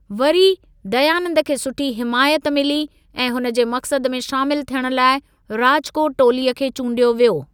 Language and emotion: Sindhi, neutral